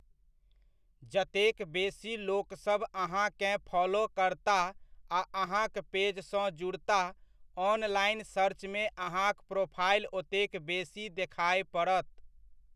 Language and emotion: Maithili, neutral